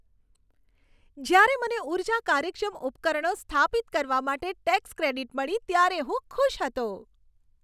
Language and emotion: Gujarati, happy